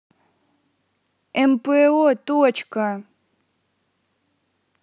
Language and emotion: Russian, neutral